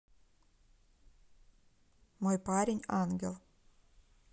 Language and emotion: Russian, neutral